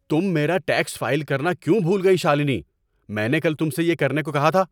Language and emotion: Urdu, angry